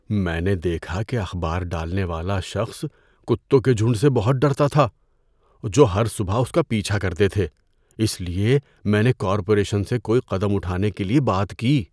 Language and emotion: Urdu, fearful